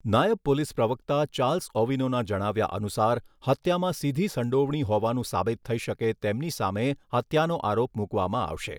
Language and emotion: Gujarati, neutral